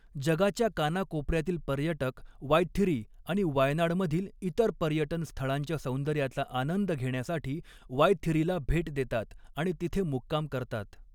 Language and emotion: Marathi, neutral